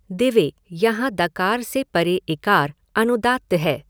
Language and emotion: Hindi, neutral